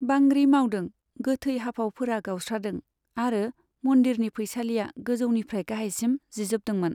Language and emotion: Bodo, neutral